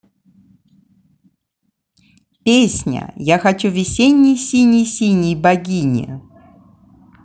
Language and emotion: Russian, positive